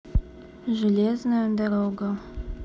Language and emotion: Russian, neutral